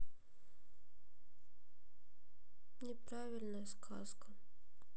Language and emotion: Russian, sad